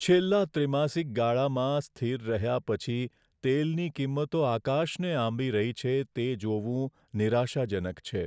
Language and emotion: Gujarati, sad